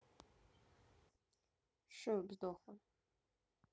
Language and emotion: Russian, sad